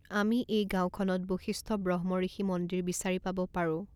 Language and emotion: Assamese, neutral